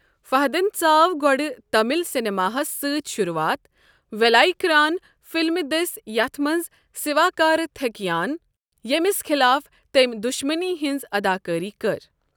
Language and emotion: Kashmiri, neutral